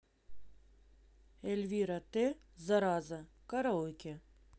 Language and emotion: Russian, neutral